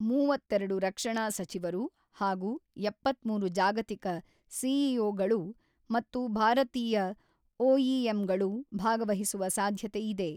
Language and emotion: Kannada, neutral